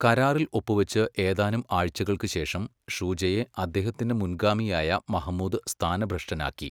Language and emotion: Malayalam, neutral